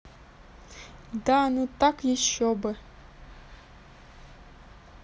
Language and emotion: Russian, neutral